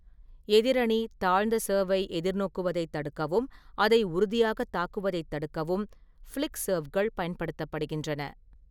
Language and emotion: Tamil, neutral